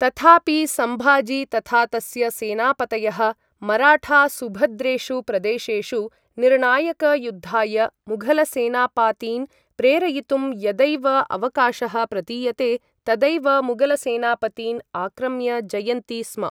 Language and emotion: Sanskrit, neutral